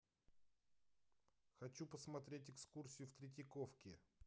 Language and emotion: Russian, neutral